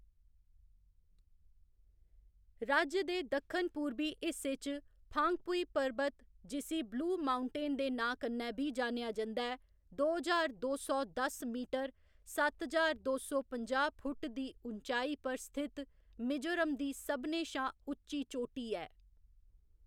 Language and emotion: Dogri, neutral